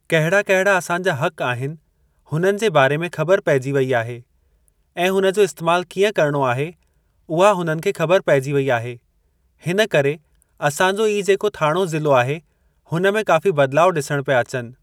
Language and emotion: Sindhi, neutral